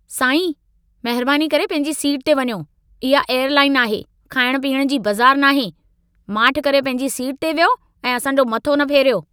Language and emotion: Sindhi, angry